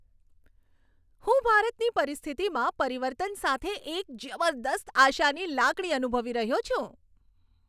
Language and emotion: Gujarati, happy